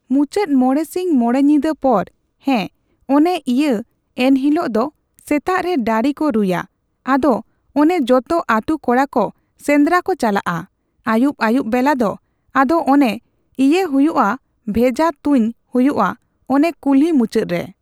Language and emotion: Santali, neutral